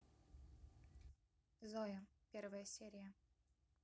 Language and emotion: Russian, neutral